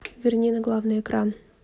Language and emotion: Russian, neutral